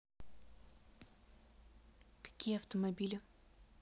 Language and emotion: Russian, neutral